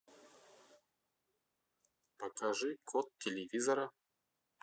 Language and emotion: Russian, positive